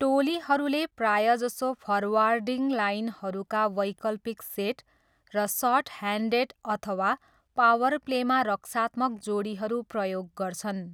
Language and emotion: Nepali, neutral